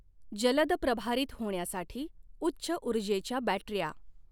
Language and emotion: Marathi, neutral